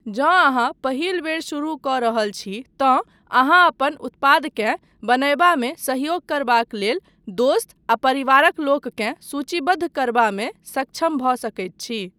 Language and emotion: Maithili, neutral